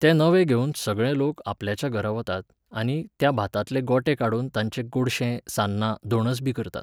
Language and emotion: Goan Konkani, neutral